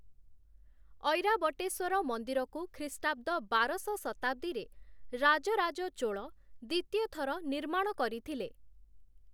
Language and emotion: Odia, neutral